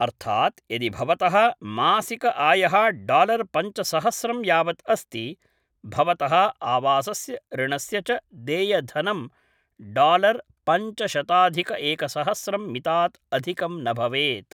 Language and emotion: Sanskrit, neutral